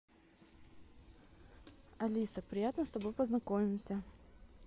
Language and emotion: Russian, positive